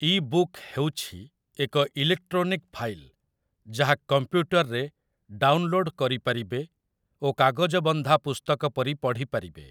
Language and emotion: Odia, neutral